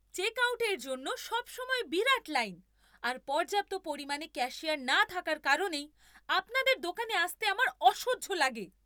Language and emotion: Bengali, angry